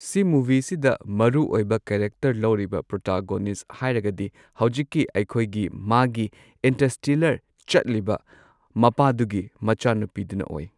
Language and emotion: Manipuri, neutral